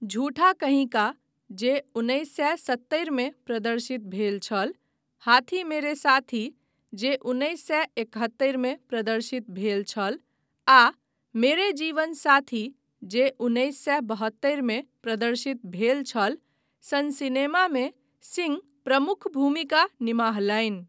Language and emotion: Maithili, neutral